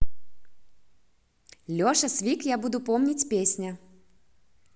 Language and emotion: Russian, positive